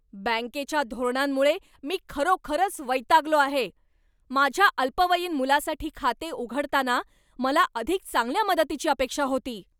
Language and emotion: Marathi, angry